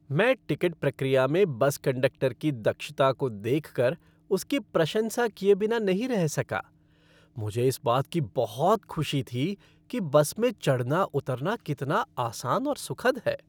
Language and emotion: Hindi, happy